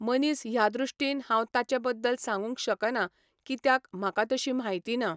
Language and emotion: Goan Konkani, neutral